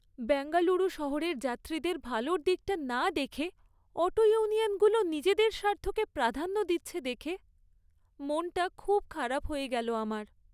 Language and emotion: Bengali, sad